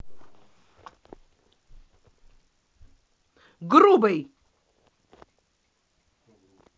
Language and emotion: Russian, angry